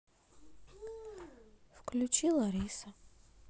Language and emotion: Russian, sad